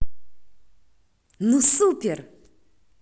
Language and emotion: Russian, positive